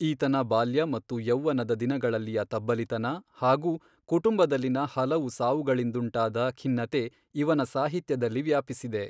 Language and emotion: Kannada, neutral